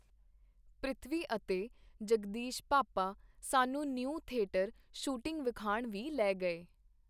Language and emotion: Punjabi, neutral